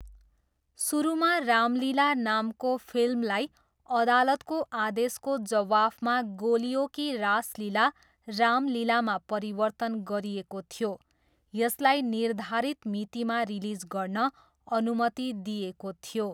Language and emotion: Nepali, neutral